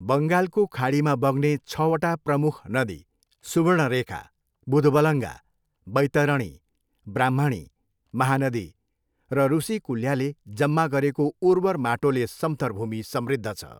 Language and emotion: Nepali, neutral